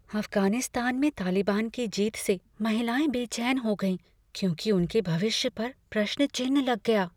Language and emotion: Hindi, fearful